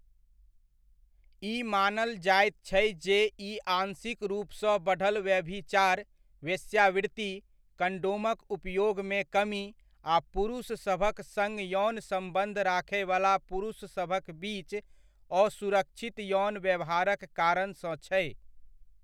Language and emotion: Maithili, neutral